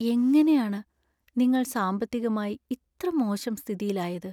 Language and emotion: Malayalam, sad